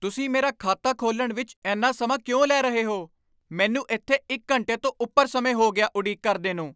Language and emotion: Punjabi, angry